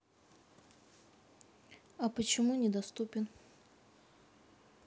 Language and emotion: Russian, neutral